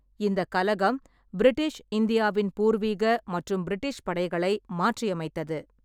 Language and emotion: Tamil, neutral